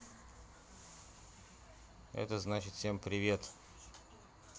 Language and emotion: Russian, neutral